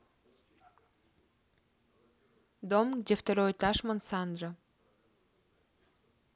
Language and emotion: Russian, neutral